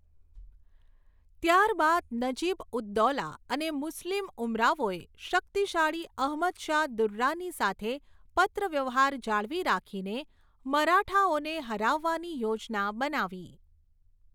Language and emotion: Gujarati, neutral